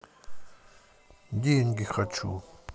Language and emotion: Russian, neutral